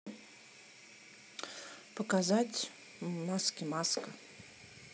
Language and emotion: Russian, neutral